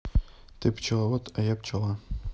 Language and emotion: Russian, neutral